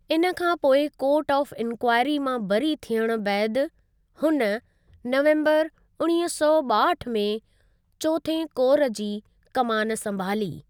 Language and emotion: Sindhi, neutral